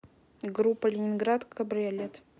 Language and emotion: Russian, neutral